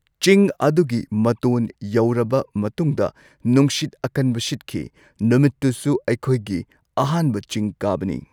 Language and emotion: Manipuri, neutral